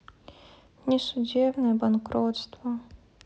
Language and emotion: Russian, sad